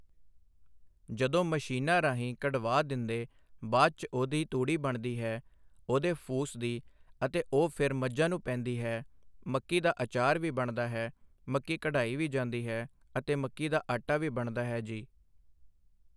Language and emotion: Punjabi, neutral